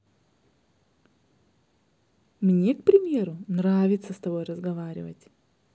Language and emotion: Russian, positive